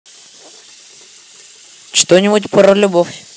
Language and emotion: Russian, neutral